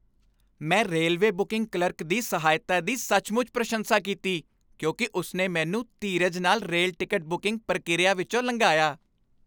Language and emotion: Punjabi, happy